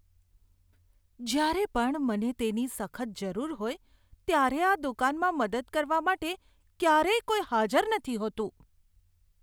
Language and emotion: Gujarati, disgusted